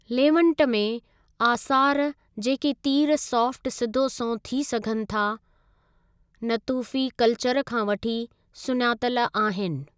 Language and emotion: Sindhi, neutral